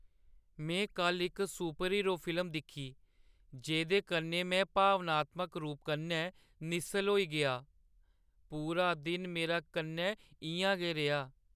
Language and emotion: Dogri, sad